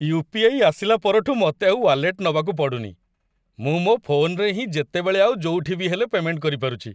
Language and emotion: Odia, happy